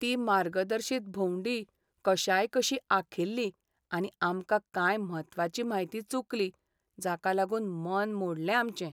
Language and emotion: Goan Konkani, sad